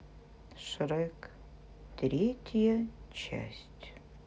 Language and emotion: Russian, sad